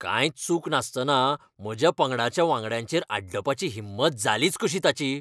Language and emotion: Goan Konkani, angry